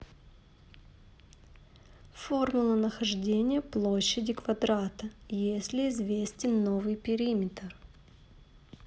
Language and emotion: Russian, neutral